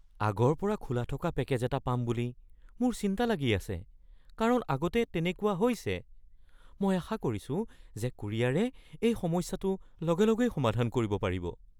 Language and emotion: Assamese, fearful